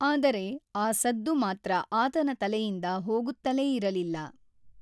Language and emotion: Kannada, neutral